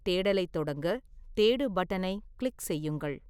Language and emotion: Tamil, neutral